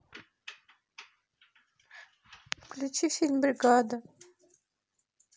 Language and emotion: Russian, sad